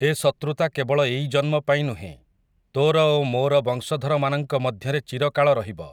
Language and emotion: Odia, neutral